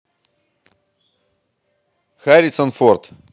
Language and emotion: Russian, neutral